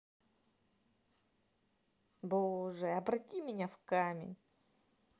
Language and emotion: Russian, neutral